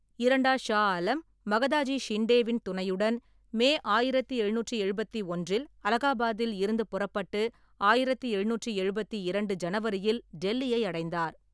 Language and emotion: Tamil, neutral